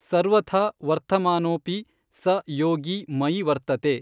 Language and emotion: Kannada, neutral